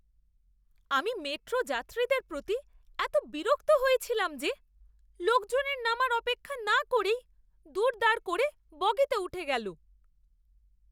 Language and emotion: Bengali, disgusted